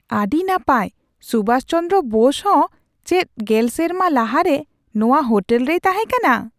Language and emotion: Santali, surprised